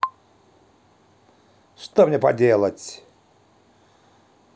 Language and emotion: Russian, neutral